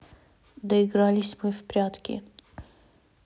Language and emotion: Russian, neutral